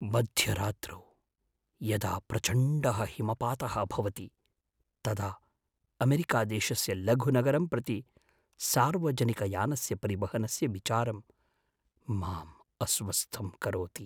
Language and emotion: Sanskrit, fearful